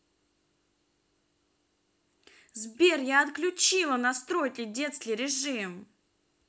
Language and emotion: Russian, angry